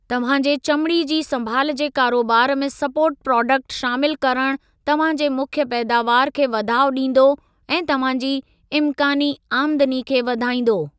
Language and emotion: Sindhi, neutral